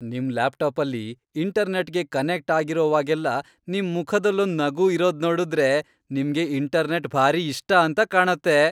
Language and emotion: Kannada, happy